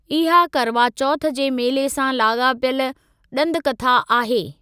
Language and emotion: Sindhi, neutral